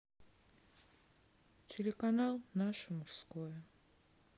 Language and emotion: Russian, sad